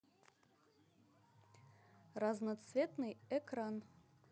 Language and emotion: Russian, neutral